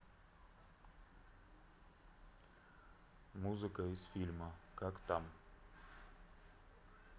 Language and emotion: Russian, neutral